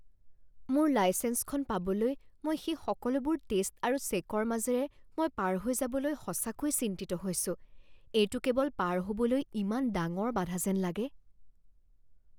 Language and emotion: Assamese, fearful